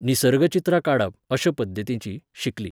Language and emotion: Goan Konkani, neutral